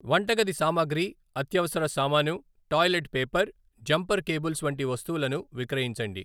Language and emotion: Telugu, neutral